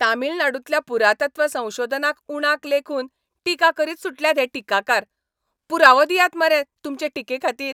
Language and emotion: Goan Konkani, angry